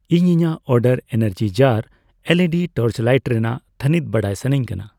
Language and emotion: Santali, neutral